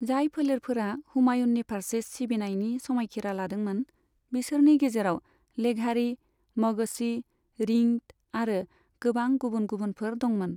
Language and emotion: Bodo, neutral